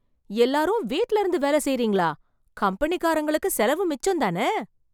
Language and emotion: Tamil, surprised